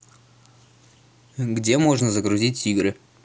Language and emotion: Russian, neutral